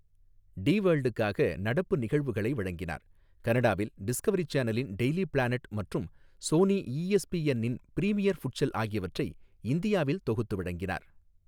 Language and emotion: Tamil, neutral